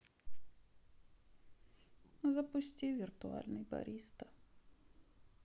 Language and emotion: Russian, sad